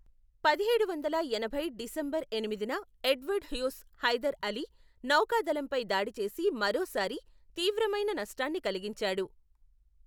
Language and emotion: Telugu, neutral